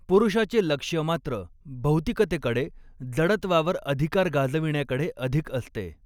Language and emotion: Marathi, neutral